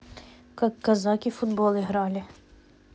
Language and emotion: Russian, neutral